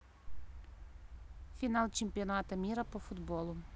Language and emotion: Russian, neutral